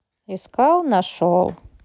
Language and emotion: Russian, neutral